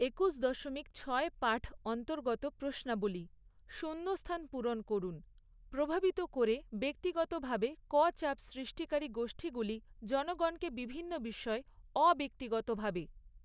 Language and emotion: Bengali, neutral